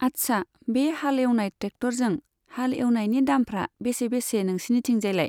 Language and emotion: Bodo, neutral